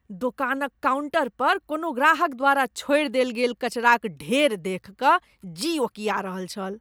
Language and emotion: Maithili, disgusted